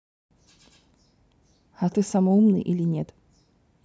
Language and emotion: Russian, neutral